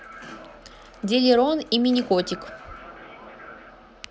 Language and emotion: Russian, neutral